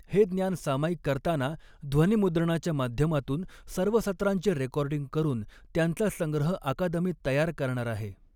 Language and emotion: Marathi, neutral